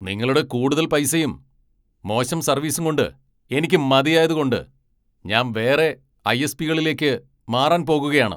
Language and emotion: Malayalam, angry